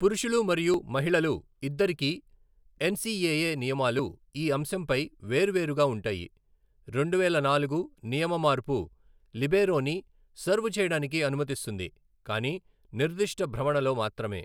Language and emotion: Telugu, neutral